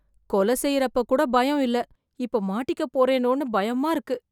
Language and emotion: Tamil, fearful